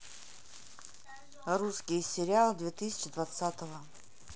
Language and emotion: Russian, neutral